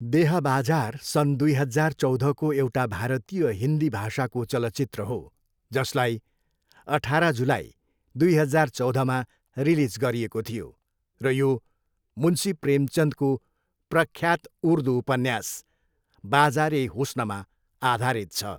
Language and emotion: Nepali, neutral